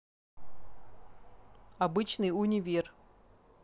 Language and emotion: Russian, neutral